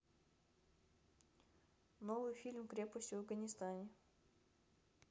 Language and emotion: Russian, neutral